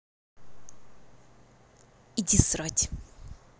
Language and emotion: Russian, angry